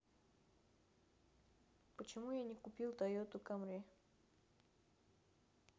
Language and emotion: Russian, neutral